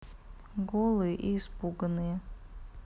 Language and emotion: Russian, neutral